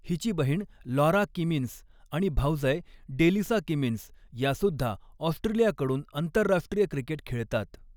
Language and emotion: Marathi, neutral